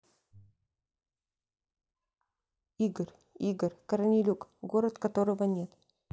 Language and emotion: Russian, neutral